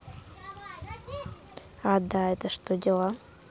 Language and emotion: Russian, neutral